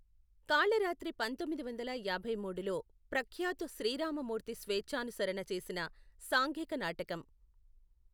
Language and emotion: Telugu, neutral